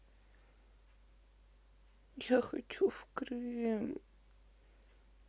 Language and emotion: Russian, sad